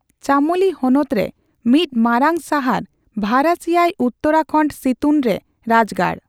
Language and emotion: Santali, neutral